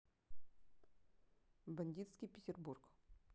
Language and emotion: Russian, neutral